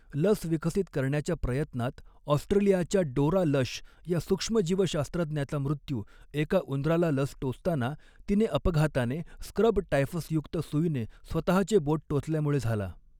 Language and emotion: Marathi, neutral